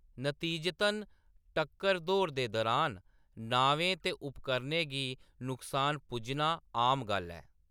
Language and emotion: Dogri, neutral